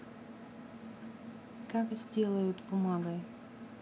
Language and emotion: Russian, neutral